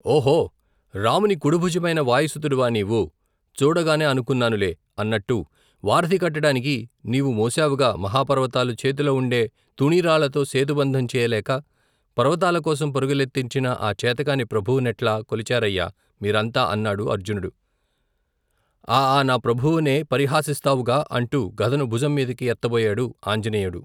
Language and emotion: Telugu, neutral